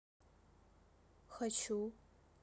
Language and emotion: Russian, neutral